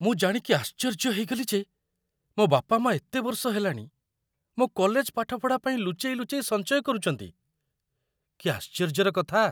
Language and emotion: Odia, surprised